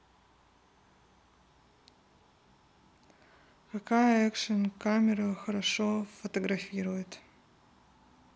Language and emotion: Russian, neutral